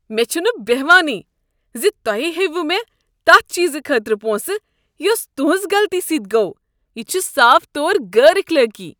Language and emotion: Kashmiri, disgusted